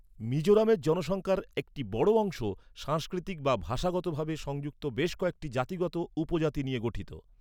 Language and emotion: Bengali, neutral